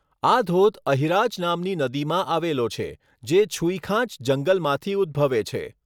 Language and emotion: Gujarati, neutral